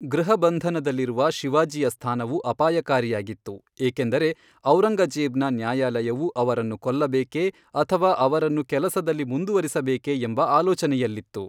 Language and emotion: Kannada, neutral